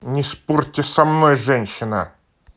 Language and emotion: Russian, angry